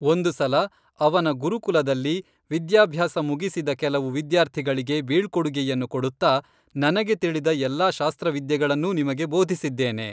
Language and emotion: Kannada, neutral